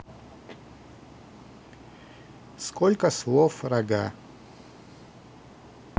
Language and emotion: Russian, neutral